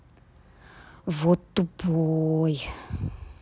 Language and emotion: Russian, angry